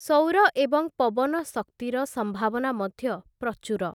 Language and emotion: Odia, neutral